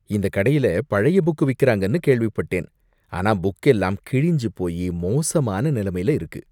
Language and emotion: Tamil, disgusted